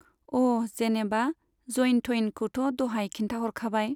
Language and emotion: Bodo, neutral